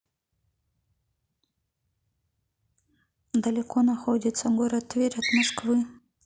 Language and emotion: Russian, neutral